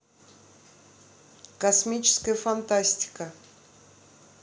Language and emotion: Russian, neutral